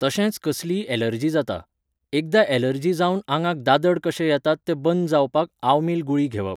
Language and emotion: Goan Konkani, neutral